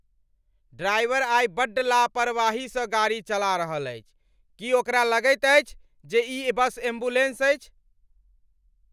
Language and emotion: Maithili, angry